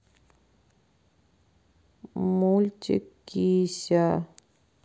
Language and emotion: Russian, sad